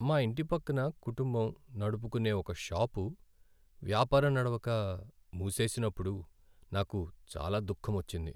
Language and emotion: Telugu, sad